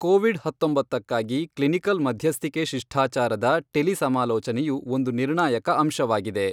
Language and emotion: Kannada, neutral